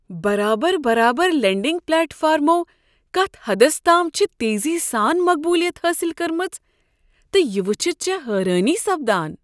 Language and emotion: Kashmiri, surprised